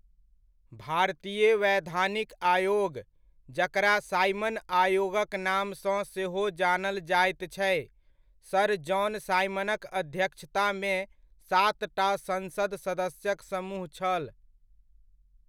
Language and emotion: Maithili, neutral